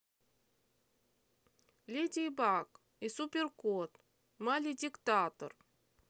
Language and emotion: Russian, neutral